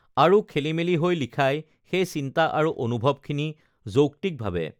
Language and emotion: Assamese, neutral